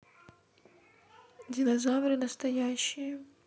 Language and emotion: Russian, neutral